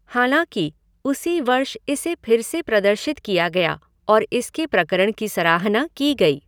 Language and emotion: Hindi, neutral